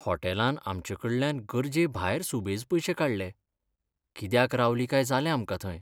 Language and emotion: Goan Konkani, sad